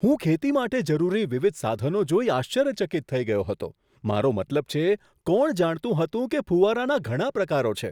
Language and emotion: Gujarati, surprised